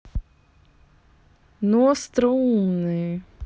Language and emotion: Russian, neutral